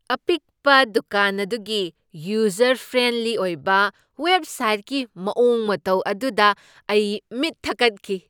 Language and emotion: Manipuri, surprised